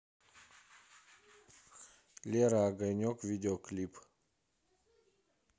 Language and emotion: Russian, neutral